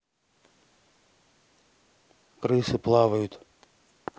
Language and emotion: Russian, neutral